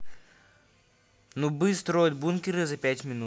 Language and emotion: Russian, neutral